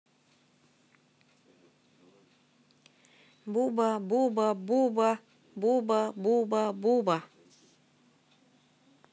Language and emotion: Russian, neutral